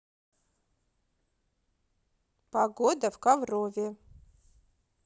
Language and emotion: Russian, neutral